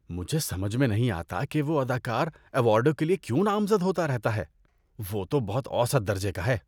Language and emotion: Urdu, disgusted